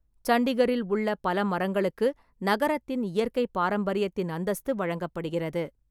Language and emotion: Tamil, neutral